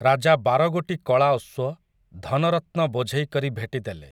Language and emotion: Odia, neutral